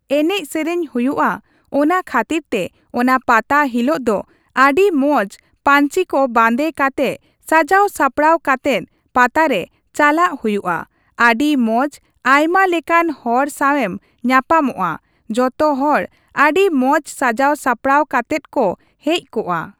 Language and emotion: Santali, neutral